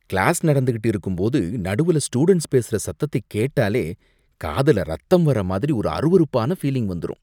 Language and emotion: Tamil, disgusted